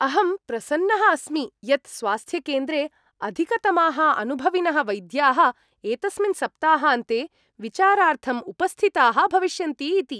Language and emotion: Sanskrit, happy